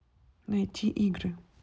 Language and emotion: Russian, neutral